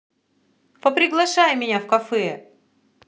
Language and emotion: Russian, positive